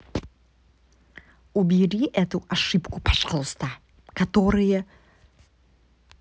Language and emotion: Russian, angry